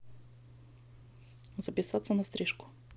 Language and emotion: Russian, neutral